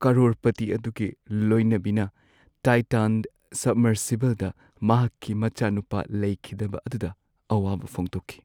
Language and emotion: Manipuri, sad